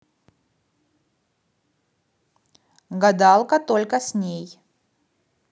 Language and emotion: Russian, neutral